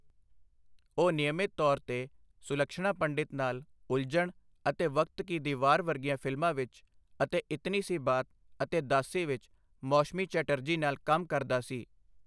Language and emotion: Punjabi, neutral